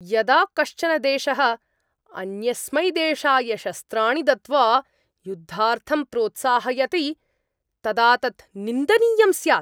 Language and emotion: Sanskrit, angry